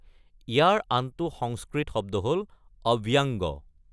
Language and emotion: Assamese, neutral